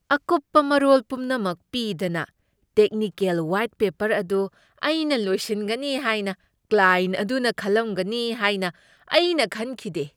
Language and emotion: Manipuri, surprised